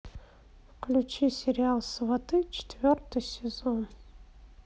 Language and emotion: Russian, neutral